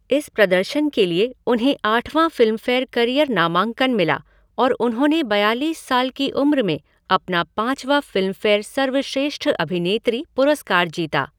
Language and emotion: Hindi, neutral